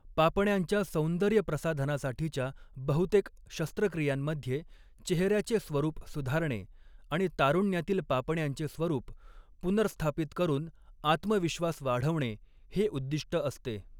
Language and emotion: Marathi, neutral